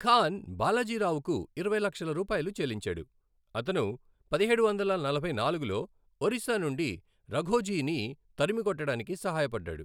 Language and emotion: Telugu, neutral